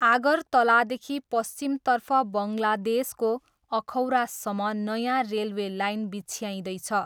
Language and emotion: Nepali, neutral